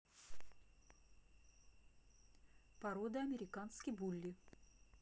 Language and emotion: Russian, neutral